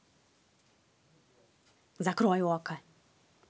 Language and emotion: Russian, angry